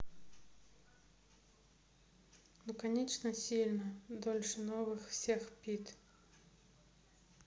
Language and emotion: Russian, sad